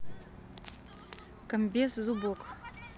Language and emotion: Russian, neutral